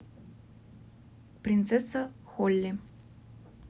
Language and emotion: Russian, neutral